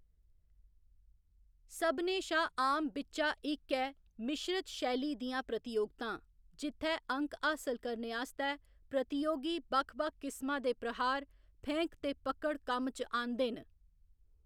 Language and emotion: Dogri, neutral